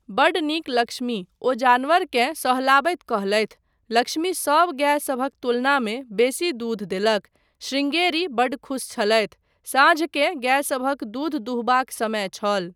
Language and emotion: Maithili, neutral